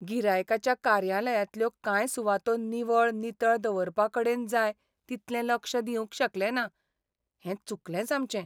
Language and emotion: Goan Konkani, sad